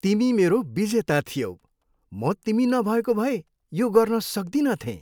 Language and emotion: Nepali, happy